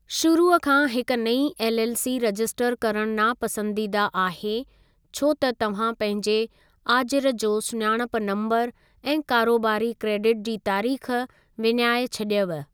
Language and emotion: Sindhi, neutral